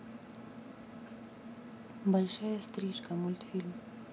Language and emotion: Russian, neutral